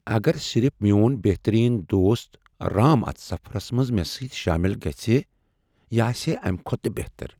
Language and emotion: Kashmiri, sad